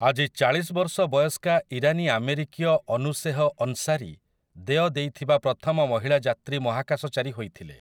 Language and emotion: Odia, neutral